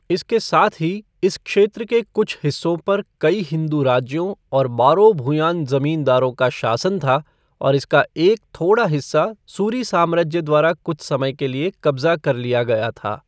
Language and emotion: Hindi, neutral